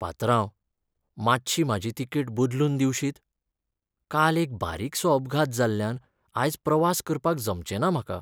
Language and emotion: Goan Konkani, sad